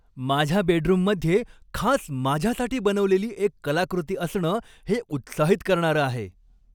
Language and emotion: Marathi, happy